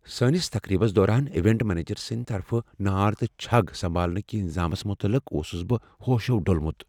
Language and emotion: Kashmiri, fearful